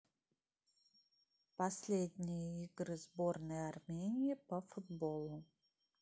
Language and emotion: Russian, neutral